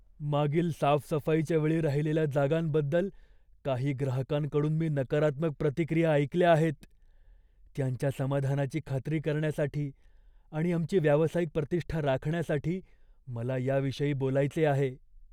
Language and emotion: Marathi, fearful